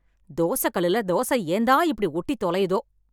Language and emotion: Tamil, angry